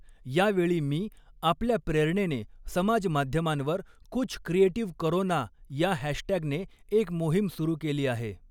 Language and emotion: Marathi, neutral